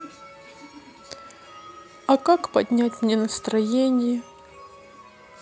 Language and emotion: Russian, sad